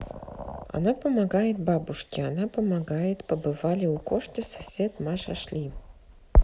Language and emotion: Russian, neutral